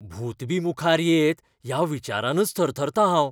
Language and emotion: Goan Konkani, fearful